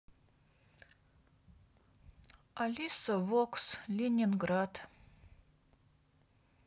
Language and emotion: Russian, neutral